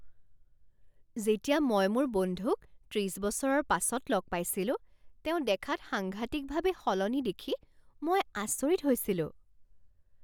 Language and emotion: Assamese, surprised